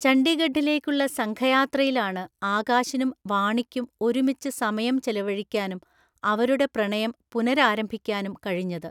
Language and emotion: Malayalam, neutral